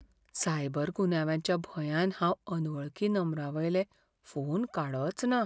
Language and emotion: Goan Konkani, fearful